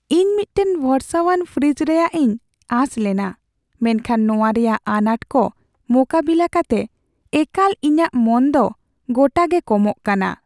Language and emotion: Santali, sad